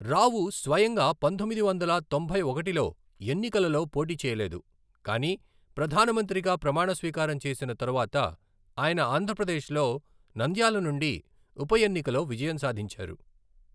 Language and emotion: Telugu, neutral